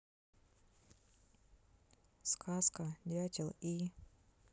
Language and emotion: Russian, neutral